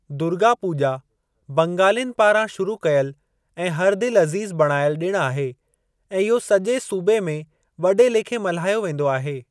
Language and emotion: Sindhi, neutral